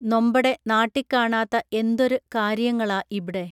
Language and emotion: Malayalam, neutral